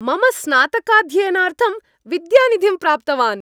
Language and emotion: Sanskrit, happy